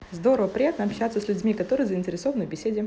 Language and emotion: Russian, positive